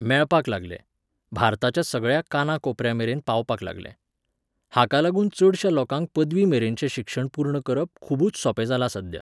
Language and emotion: Goan Konkani, neutral